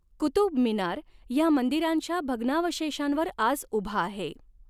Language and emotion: Marathi, neutral